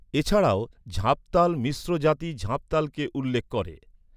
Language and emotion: Bengali, neutral